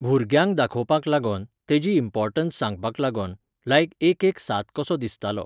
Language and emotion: Goan Konkani, neutral